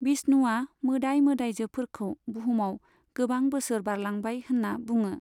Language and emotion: Bodo, neutral